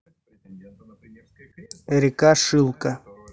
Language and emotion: Russian, neutral